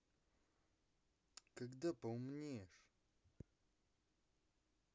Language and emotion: Russian, angry